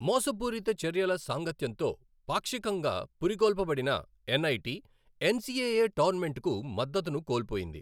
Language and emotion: Telugu, neutral